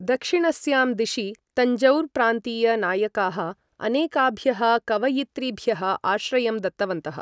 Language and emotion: Sanskrit, neutral